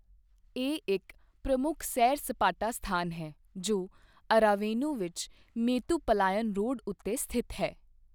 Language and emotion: Punjabi, neutral